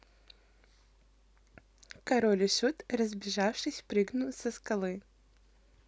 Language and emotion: Russian, positive